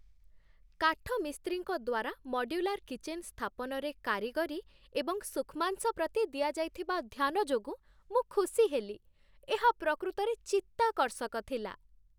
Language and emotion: Odia, happy